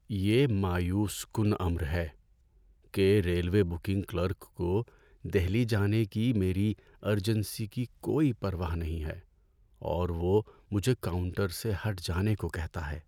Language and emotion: Urdu, sad